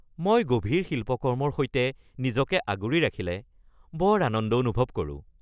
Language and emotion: Assamese, happy